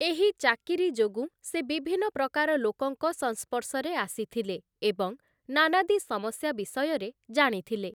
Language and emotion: Odia, neutral